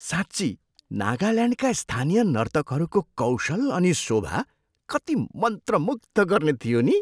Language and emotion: Nepali, surprised